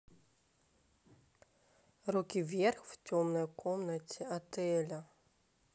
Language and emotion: Russian, neutral